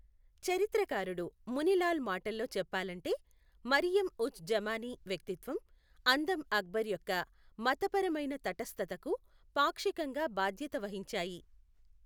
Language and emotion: Telugu, neutral